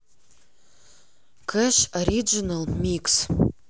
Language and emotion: Russian, neutral